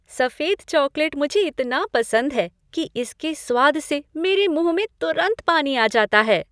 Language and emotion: Hindi, happy